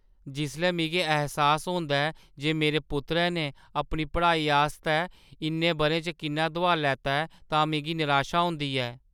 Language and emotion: Dogri, sad